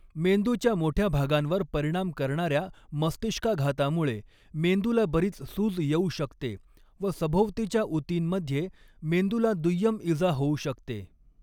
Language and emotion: Marathi, neutral